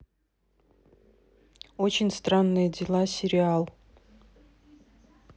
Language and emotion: Russian, neutral